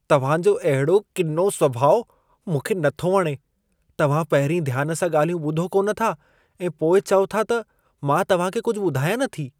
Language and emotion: Sindhi, disgusted